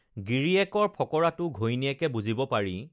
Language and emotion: Assamese, neutral